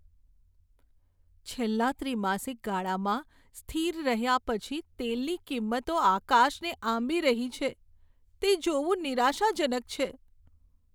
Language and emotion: Gujarati, sad